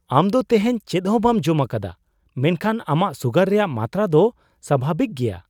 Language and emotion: Santali, surprised